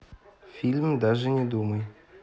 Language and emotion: Russian, neutral